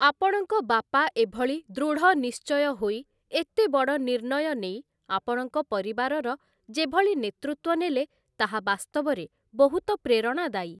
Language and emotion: Odia, neutral